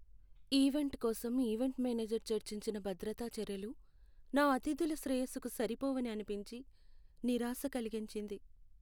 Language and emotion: Telugu, sad